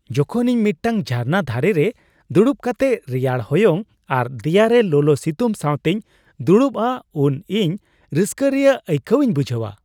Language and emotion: Santali, happy